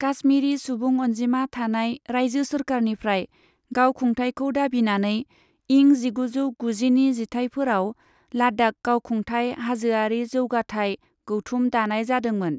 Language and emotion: Bodo, neutral